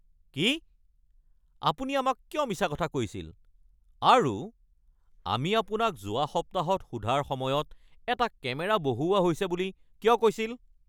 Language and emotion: Assamese, angry